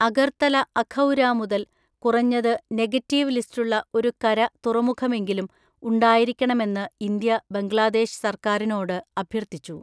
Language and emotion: Malayalam, neutral